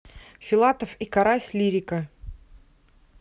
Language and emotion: Russian, neutral